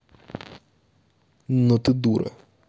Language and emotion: Russian, angry